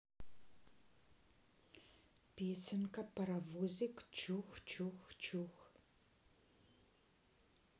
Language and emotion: Russian, neutral